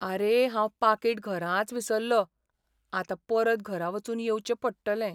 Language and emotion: Goan Konkani, sad